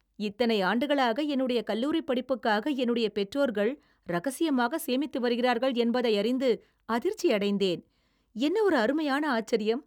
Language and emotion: Tamil, surprised